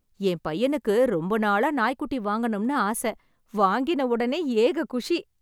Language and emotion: Tamil, happy